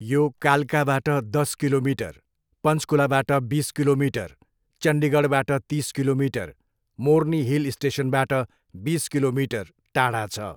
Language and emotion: Nepali, neutral